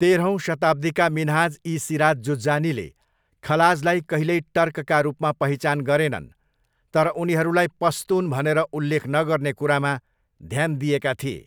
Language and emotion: Nepali, neutral